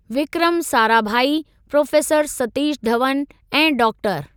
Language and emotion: Sindhi, neutral